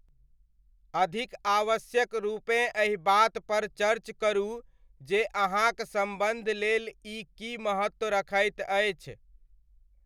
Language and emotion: Maithili, neutral